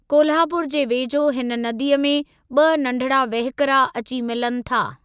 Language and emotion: Sindhi, neutral